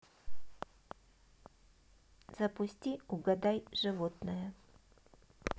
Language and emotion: Russian, neutral